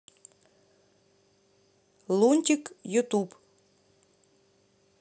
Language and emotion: Russian, neutral